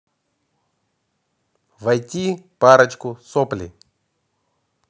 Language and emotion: Russian, neutral